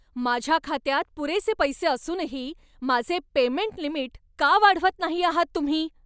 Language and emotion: Marathi, angry